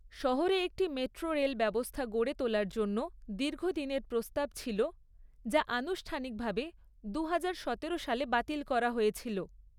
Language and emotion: Bengali, neutral